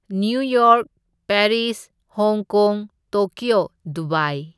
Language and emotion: Manipuri, neutral